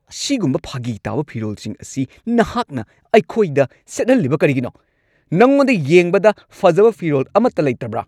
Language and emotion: Manipuri, angry